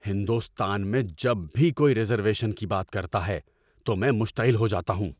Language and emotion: Urdu, angry